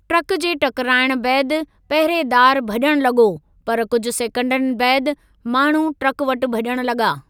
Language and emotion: Sindhi, neutral